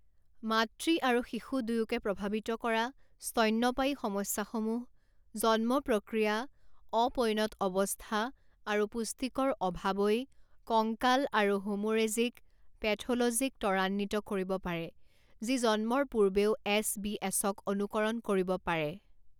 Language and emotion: Assamese, neutral